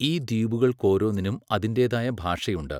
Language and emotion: Malayalam, neutral